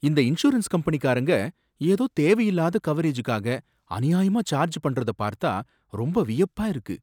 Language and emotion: Tamil, surprised